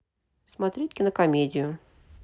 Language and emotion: Russian, neutral